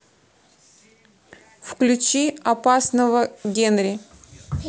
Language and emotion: Russian, neutral